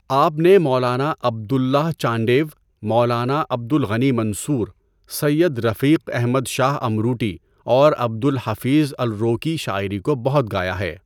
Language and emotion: Urdu, neutral